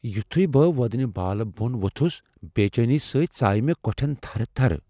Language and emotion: Kashmiri, fearful